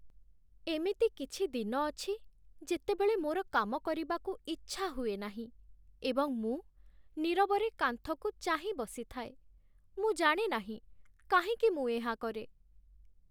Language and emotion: Odia, sad